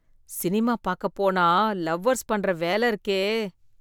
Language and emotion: Tamil, disgusted